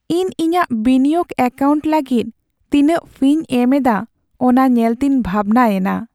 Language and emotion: Santali, sad